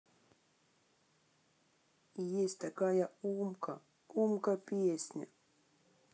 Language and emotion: Russian, sad